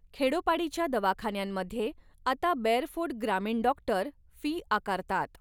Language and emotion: Marathi, neutral